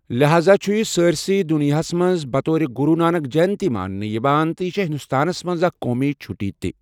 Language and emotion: Kashmiri, neutral